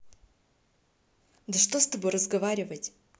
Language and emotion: Russian, neutral